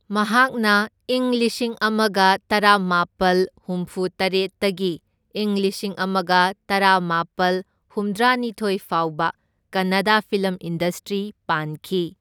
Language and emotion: Manipuri, neutral